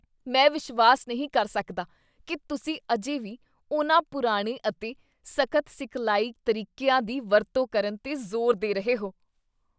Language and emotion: Punjabi, disgusted